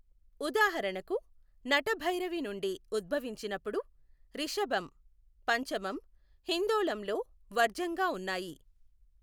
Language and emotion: Telugu, neutral